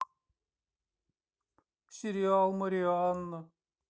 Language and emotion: Russian, sad